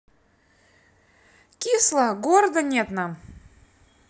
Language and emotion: Russian, neutral